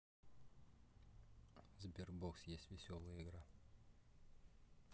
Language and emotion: Russian, neutral